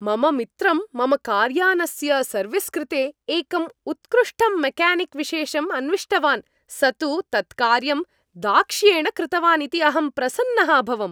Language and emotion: Sanskrit, happy